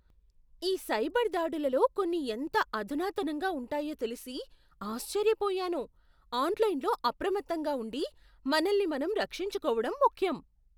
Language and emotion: Telugu, surprised